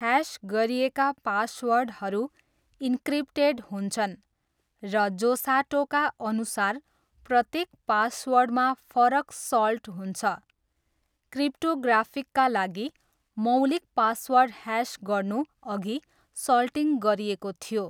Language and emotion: Nepali, neutral